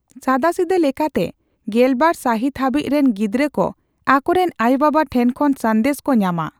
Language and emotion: Santali, neutral